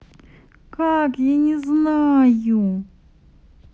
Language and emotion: Russian, sad